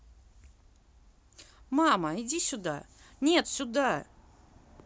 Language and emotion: Russian, neutral